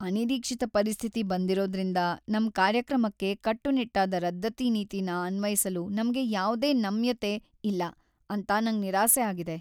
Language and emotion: Kannada, sad